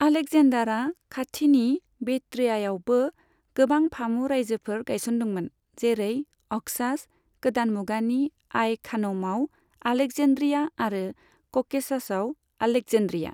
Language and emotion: Bodo, neutral